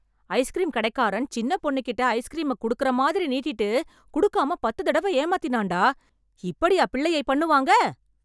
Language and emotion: Tamil, angry